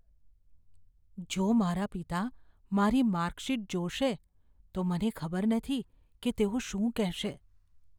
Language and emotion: Gujarati, fearful